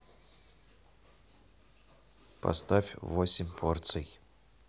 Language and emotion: Russian, neutral